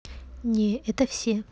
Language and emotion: Russian, neutral